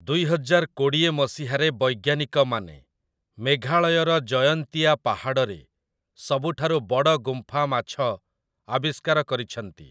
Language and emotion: Odia, neutral